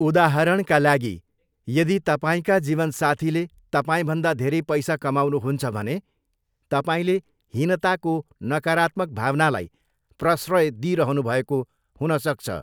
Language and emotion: Nepali, neutral